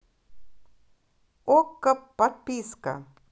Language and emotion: Russian, positive